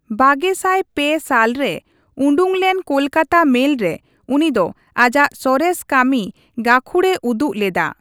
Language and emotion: Santali, neutral